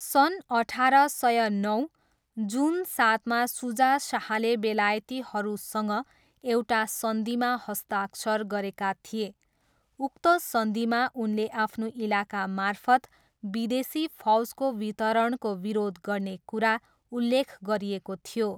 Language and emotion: Nepali, neutral